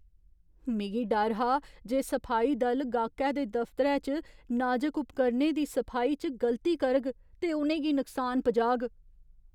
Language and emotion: Dogri, fearful